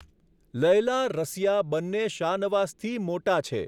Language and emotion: Gujarati, neutral